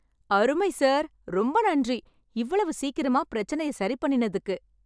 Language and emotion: Tamil, happy